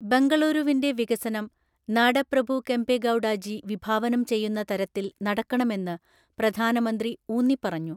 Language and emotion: Malayalam, neutral